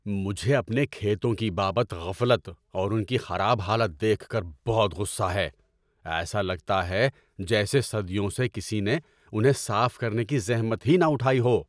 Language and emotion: Urdu, angry